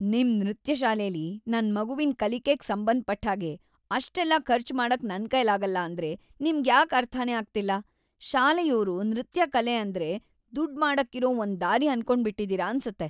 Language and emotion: Kannada, disgusted